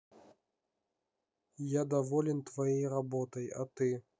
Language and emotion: Russian, neutral